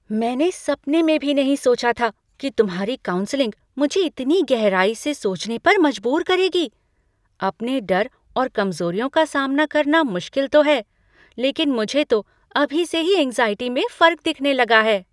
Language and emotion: Hindi, surprised